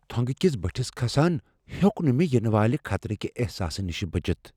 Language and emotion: Kashmiri, fearful